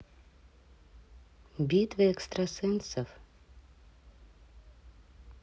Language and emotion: Russian, neutral